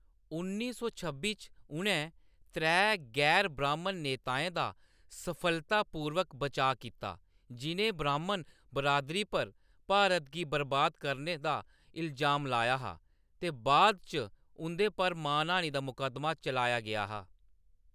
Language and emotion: Dogri, neutral